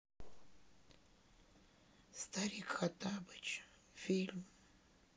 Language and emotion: Russian, sad